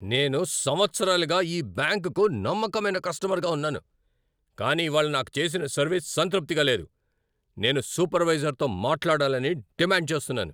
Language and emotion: Telugu, angry